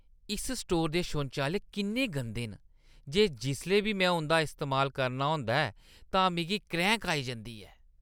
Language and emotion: Dogri, disgusted